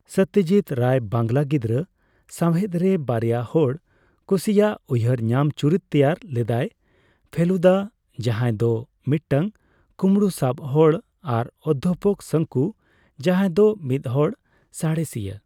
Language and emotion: Santali, neutral